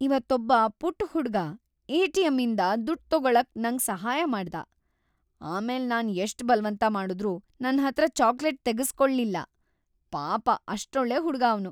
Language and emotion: Kannada, happy